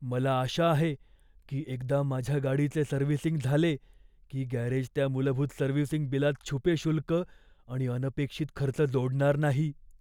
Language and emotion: Marathi, fearful